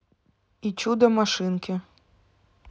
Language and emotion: Russian, neutral